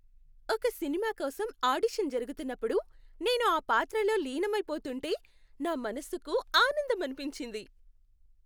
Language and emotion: Telugu, happy